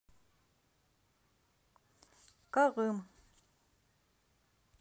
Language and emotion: Russian, neutral